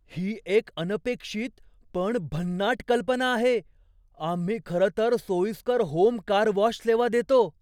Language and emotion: Marathi, surprised